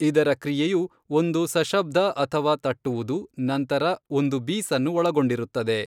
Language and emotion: Kannada, neutral